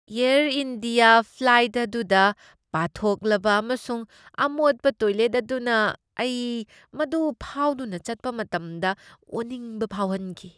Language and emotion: Manipuri, disgusted